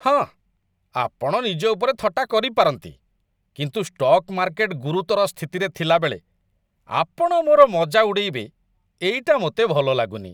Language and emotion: Odia, disgusted